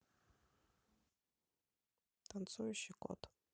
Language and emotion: Russian, neutral